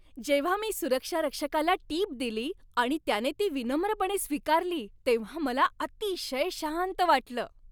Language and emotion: Marathi, happy